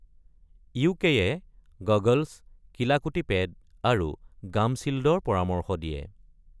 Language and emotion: Assamese, neutral